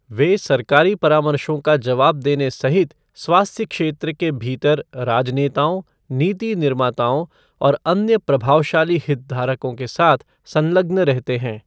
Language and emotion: Hindi, neutral